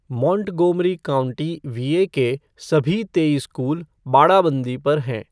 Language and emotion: Hindi, neutral